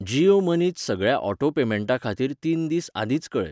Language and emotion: Goan Konkani, neutral